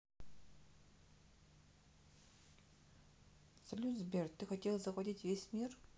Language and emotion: Russian, neutral